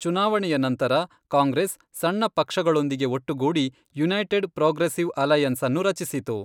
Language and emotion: Kannada, neutral